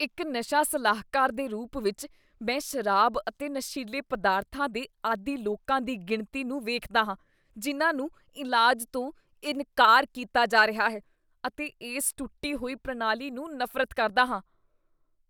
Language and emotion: Punjabi, disgusted